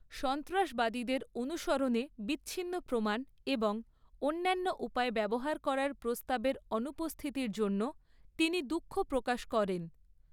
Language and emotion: Bengali, neutral